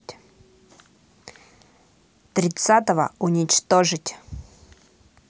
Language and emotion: Russian, neutral